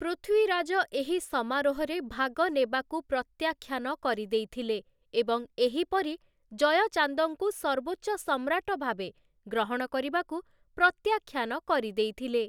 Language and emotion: Odia, neutral